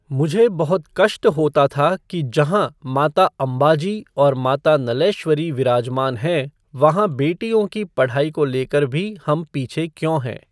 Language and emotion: Hindi, neutral